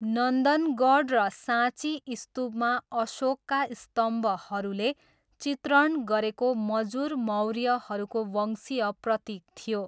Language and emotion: Nepali, neutral